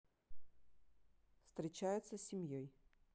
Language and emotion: Russian, neutral